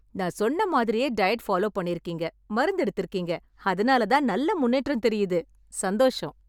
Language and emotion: Tamil, happy